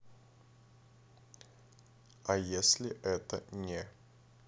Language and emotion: Russian, neutral